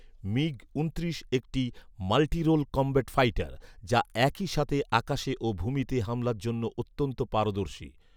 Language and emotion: Bengali, neutral